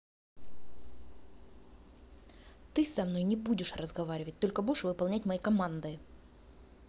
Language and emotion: Russian, angry